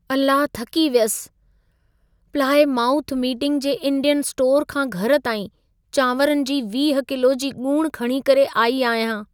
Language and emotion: Sindhi, sad